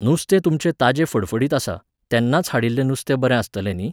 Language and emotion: Goan Konkani, neutral